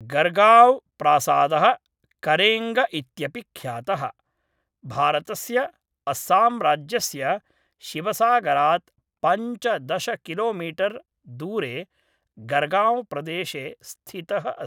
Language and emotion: Sanskrit, neutral